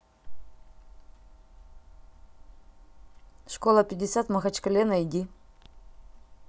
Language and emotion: Russian, neutral